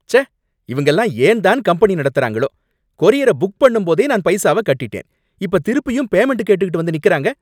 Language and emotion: Tamil, angry